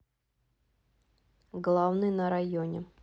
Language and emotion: Russian, neutral